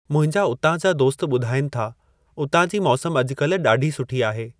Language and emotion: Sindhi, neutral